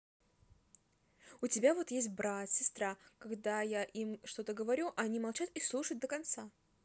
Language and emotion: Russian, neutral